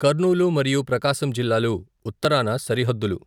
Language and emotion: Telugu, neutral